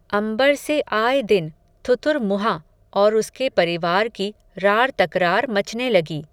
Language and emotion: Hindi, neutral